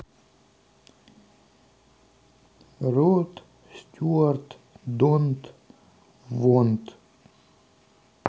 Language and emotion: Russian, neutral